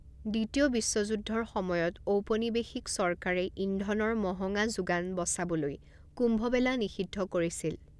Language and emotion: Assamese, neutral